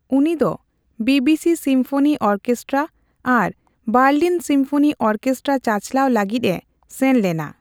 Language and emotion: Santali, neutral